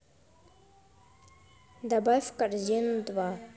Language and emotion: Russian, neutral